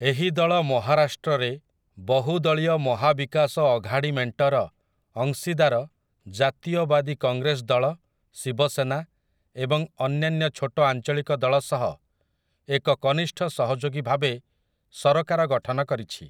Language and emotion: Odia, neutral